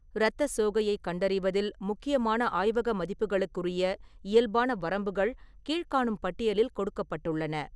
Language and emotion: Tamil, neutral